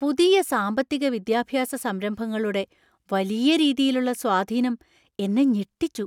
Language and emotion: Malayalam, surprised